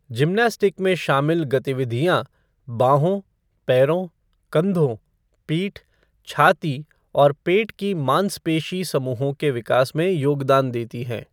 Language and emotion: Hindi, neutral